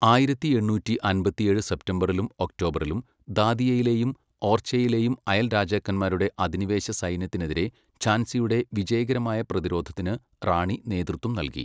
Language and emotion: Malayalam, neutral